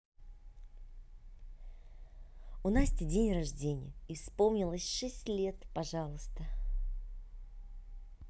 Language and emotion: Russian, positive